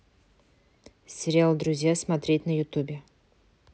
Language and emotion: Russian, neutral